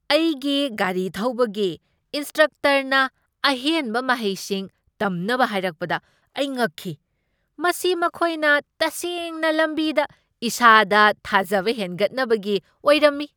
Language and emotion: Manipuri, surprised